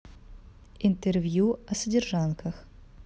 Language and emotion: Russian, neutral